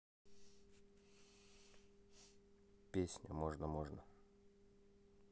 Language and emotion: Russian, neutral